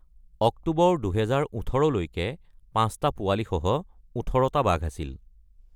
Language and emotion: Assamese, neutral